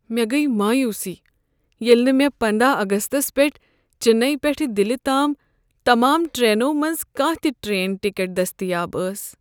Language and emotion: Kashmiri, sad